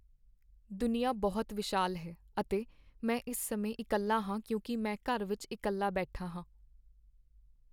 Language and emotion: Punjabi, sad